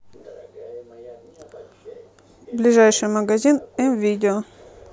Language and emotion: Russian, neutral